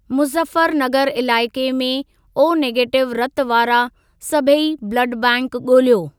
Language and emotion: Sindhi, neutral